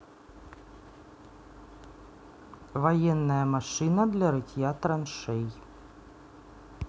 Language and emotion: Russian, neutral